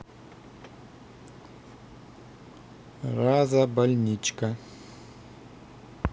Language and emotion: Russian, neutral